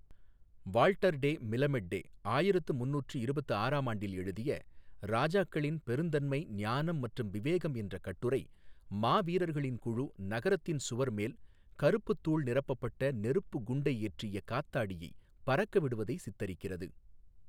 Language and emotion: Tamil, neutral